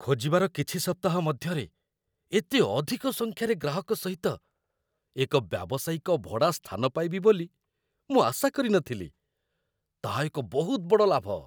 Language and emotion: Odia, surprised